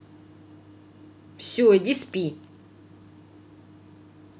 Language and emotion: Russian, angry